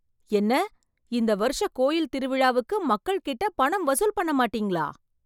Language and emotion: Tamil, surprised